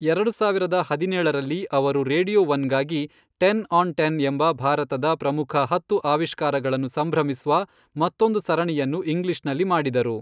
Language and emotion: Kannada, neutral